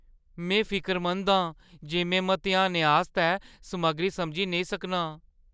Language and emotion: Dogri, fearful